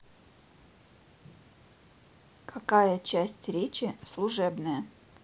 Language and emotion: Russian, neutral